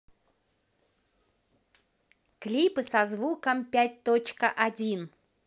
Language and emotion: Russian, positive